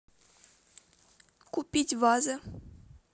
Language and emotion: Russian, neutral